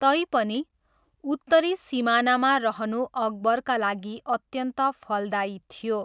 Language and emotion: Nepali, neutral